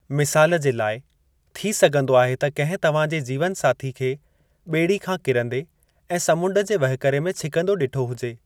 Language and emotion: Sindhi, neutral